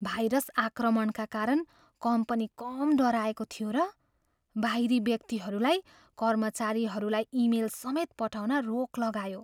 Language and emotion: Nepali, fearful